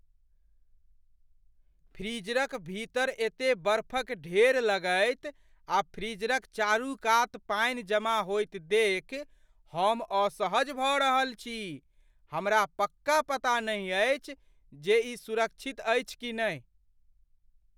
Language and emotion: Maithili, fearful